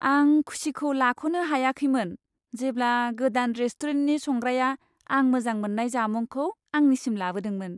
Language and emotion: Bodo, happy